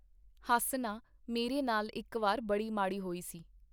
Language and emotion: Punjabi, neutral